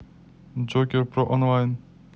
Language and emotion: Russian, neutral